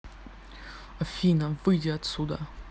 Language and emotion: Russian, angry